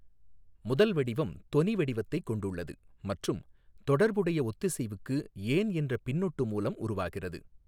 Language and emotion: Tamil, neutral